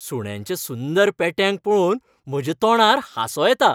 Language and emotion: Goan Konkani, happy